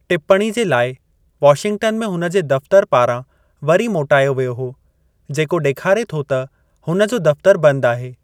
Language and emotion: Sindhi, neutral